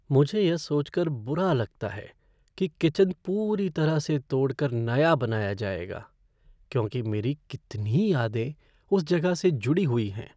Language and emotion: Hindi, sad